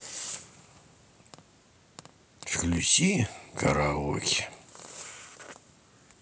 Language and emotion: Russian, sad